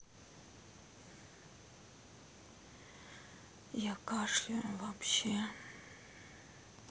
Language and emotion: Russian, sad